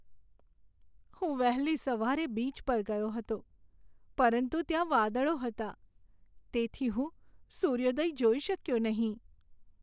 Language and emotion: Gujarati, sad